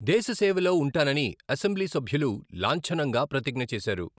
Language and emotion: Telugu, neutral